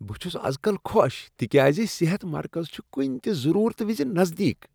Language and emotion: Kashmiri, happy